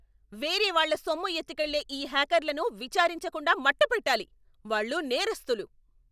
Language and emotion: Telugu, angry